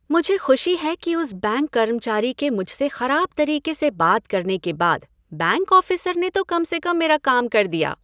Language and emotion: Hindi, happy